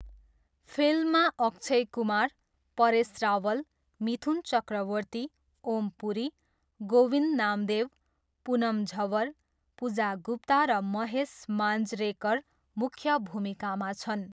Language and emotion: Nepali, neutral